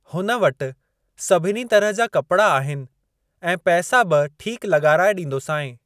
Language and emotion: Sindhi, neutral